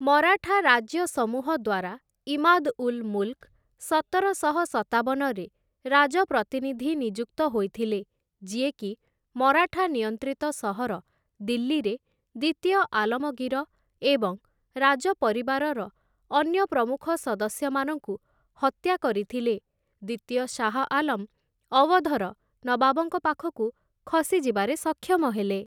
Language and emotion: Odia, neutral